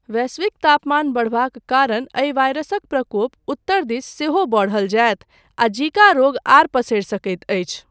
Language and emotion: Maithili, neutral